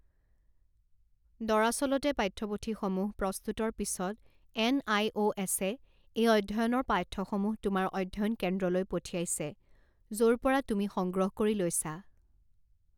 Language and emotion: Assamese, neutral